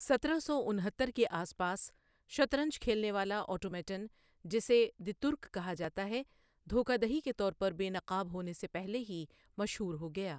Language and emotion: Urdu, neutral